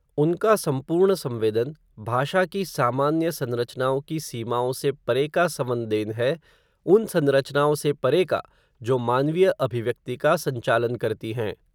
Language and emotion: Hindi, neutral